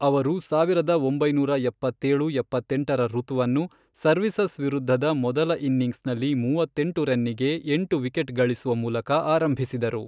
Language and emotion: Kannada, neutral